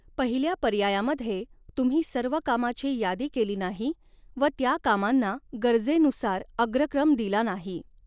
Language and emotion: Marathi, neutral